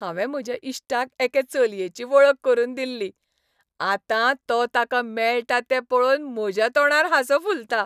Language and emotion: Goan Konkani, happy